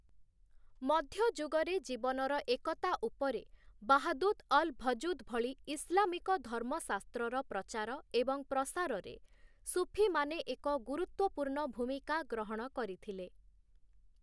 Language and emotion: Odia, neutral